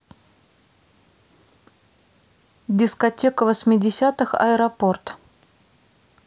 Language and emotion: Russian, neutral